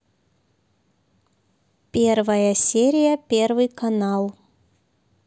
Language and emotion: Russian, neutral